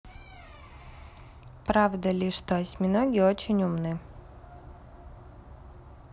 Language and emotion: Russian, neutral